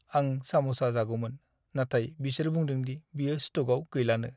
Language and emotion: Bodo, sad